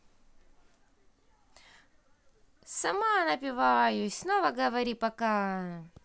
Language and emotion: Russian, positive